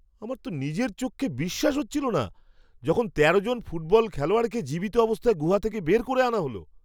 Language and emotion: Bengali, surprised